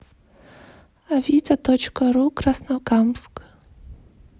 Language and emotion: Russian, neutral